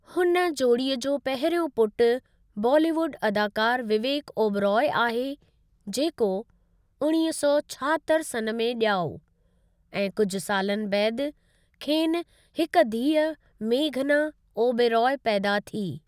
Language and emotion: Sindhi, neutral